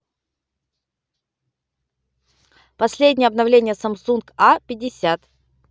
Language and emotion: Russian, neutral